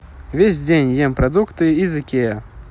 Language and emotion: Russian, neutral